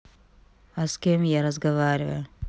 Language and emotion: Russian, neutral